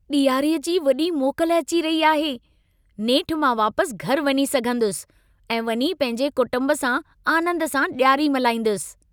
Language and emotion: Sindhi, happy